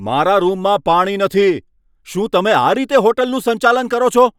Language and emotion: Gujarati, angry